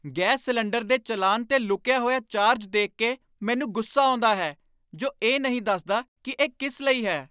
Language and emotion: Punjabi, angry